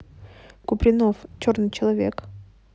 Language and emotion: Russian, neutral